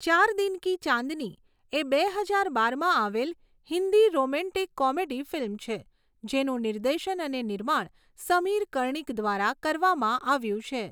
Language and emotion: Gujarati, neutral